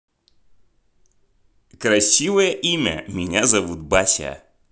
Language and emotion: Russian, positive